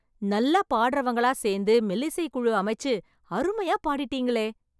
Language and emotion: Tamil, happy